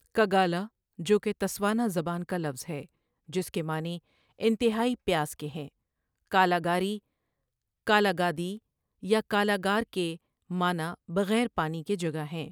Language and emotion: Urdu, neutral